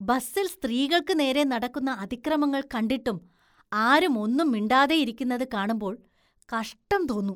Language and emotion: Malayalam, disgusted